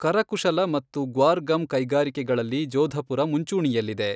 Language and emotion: Kannada, neutral